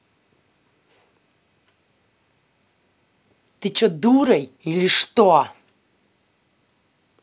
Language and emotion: Russian, angry